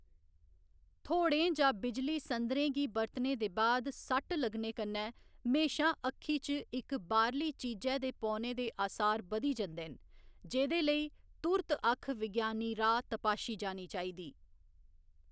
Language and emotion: Dogri, neutral